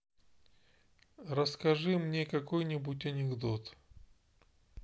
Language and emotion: Russian, neutral